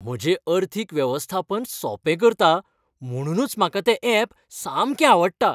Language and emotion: Goan Konkani, happy